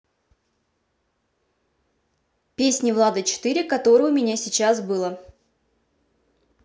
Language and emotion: Russian, neutral